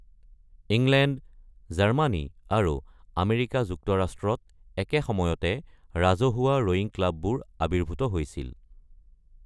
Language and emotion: Assamese, neutral